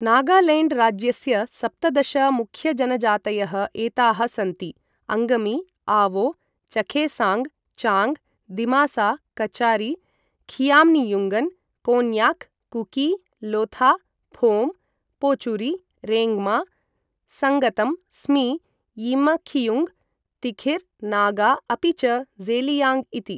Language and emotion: Sanskrit, neutral